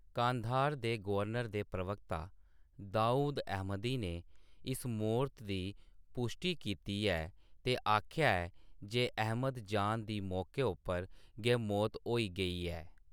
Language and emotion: Dogri, neutral